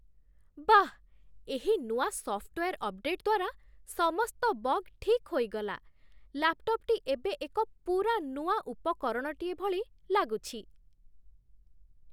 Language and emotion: Odia, surprised